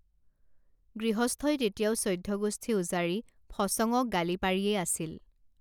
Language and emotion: Assamese, neutral